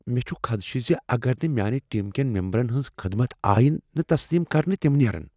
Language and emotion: Kashmiri, fearful